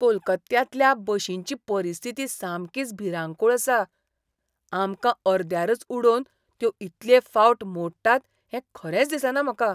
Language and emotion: Goan Konkani, disgusted